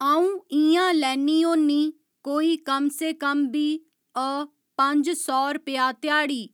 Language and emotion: Dogri, neutral